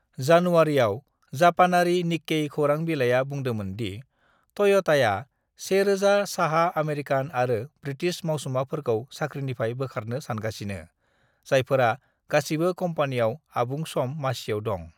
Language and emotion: Bodo, neutral